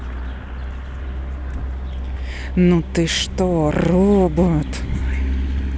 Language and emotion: Russian, angry